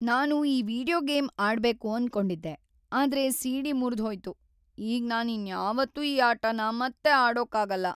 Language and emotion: Kannada, sad